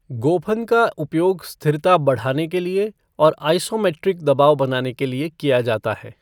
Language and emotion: Hindi, neutral